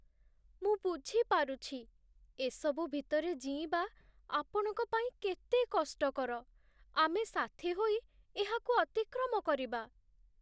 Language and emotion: Odia, sad